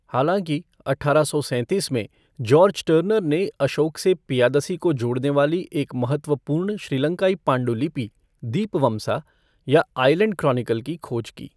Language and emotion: Hindi, neutral